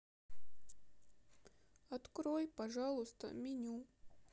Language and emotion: Russian, sad